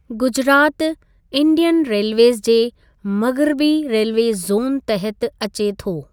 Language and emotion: Sindhi, neutral